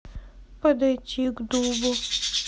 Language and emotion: Russian, sad